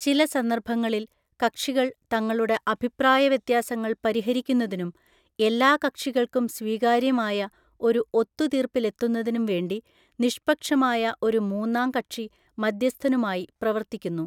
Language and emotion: Malayalam, neutral